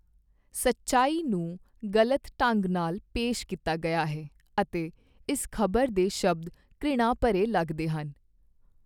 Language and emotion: Punjabi, neutral